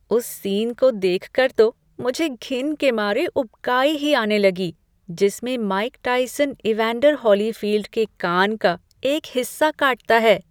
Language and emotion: Hindi, disgusted